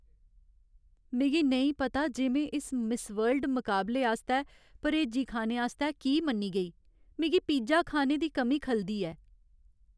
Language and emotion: Dogri, sad